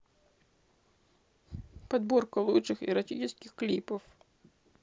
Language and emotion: Russian, sad